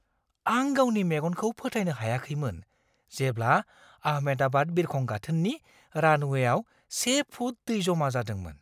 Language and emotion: Bodo, surprised